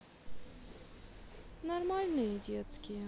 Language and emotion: Russian, sad